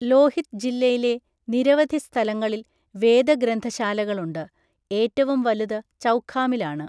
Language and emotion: Malayalam, neutral